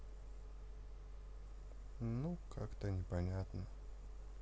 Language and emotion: Russian, sad